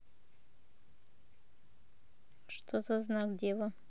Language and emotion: Russian, neutral